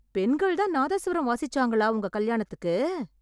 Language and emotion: Tamil, surprised